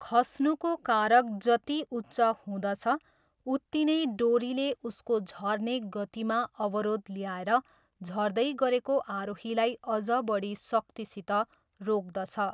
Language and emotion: Nepali, neutral